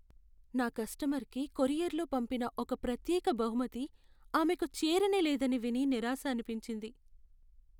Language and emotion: Telugu, sad